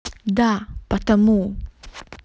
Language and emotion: Russian, angry